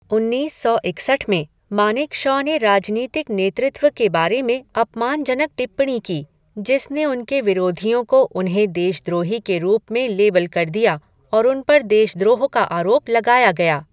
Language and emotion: Hindi, neutral